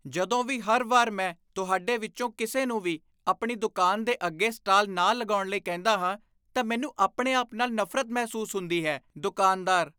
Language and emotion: Punjabi, disgusted